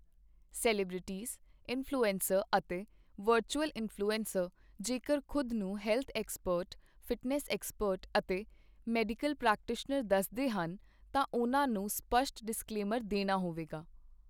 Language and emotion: Punjabi, neutral